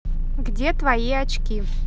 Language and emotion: Russian, neutral